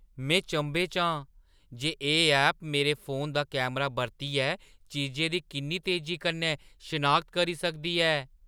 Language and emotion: Dogri, surprised